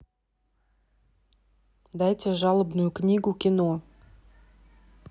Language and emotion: Russian, neutral